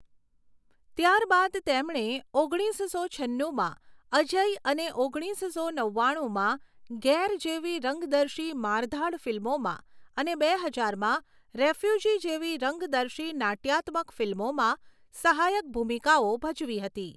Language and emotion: Gujarati, neutral